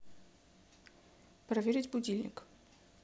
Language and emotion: Russian, neutral